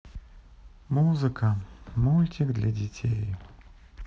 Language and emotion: Russian, sad